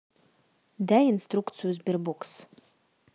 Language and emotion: Russian, neutral